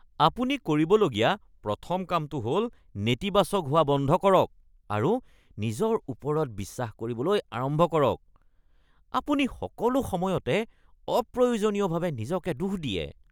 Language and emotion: Assamese, disgusted